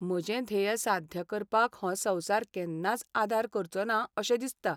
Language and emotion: Goan Konkani, sad